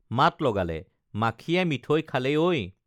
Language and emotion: Assamese, neutral